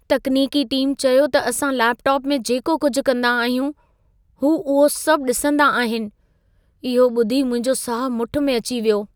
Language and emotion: Sindhi, fearful